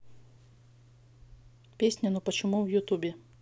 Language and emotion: Russian, neutral